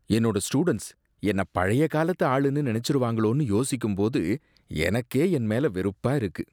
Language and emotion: Tamil, disgusted